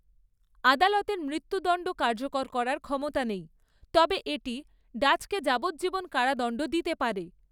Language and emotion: Bengali, neutral